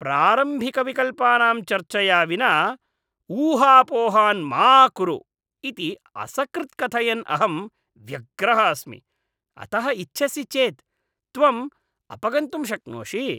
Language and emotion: Sanskrit, disgusted